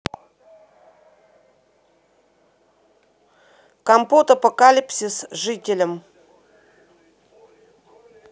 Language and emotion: Russian, neutral